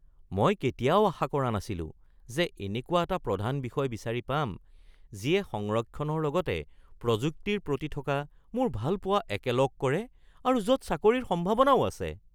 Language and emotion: Assamese, surprised